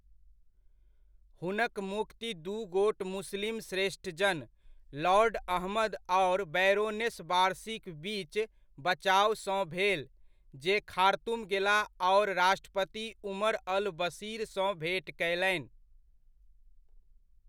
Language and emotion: Maithili, neutral